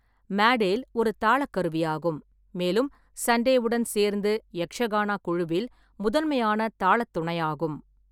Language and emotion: Tamil, neutral